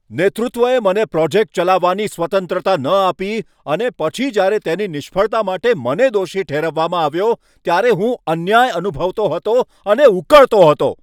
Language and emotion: Gujarati, angry